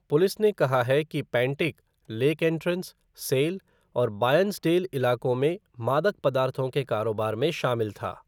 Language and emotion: Hindi, neutral